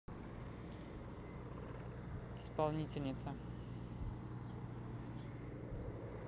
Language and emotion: Russian, neutral